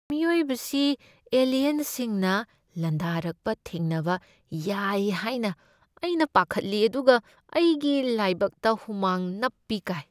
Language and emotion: Manipuri, fearful